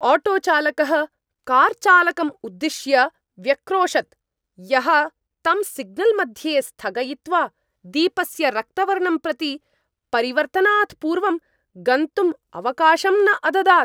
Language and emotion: Sanskrit, angry